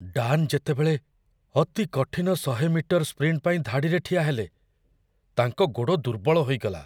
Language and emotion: Odia, fearful